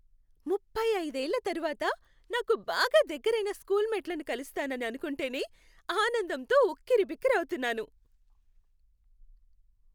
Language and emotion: Telugu, happy